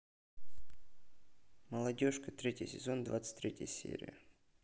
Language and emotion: Russian, neutral